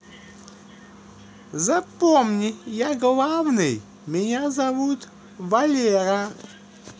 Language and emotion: Russian, positive